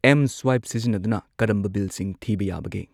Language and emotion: Manipuri, neutral